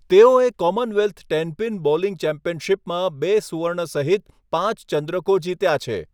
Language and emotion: Gujarati, neutral